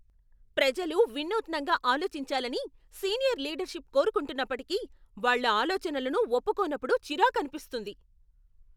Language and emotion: Telugu, angry